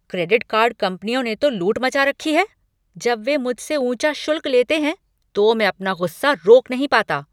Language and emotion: Hindi, angry